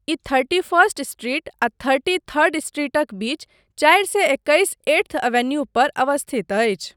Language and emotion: Maithili, neutral